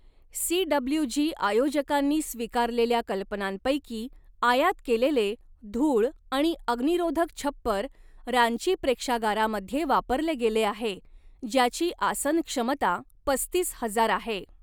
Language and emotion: Marathi, neutral